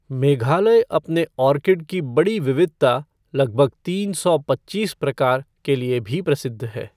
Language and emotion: Hindi, neutral